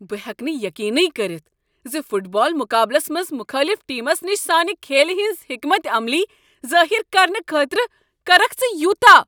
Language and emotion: Kashmiri, angry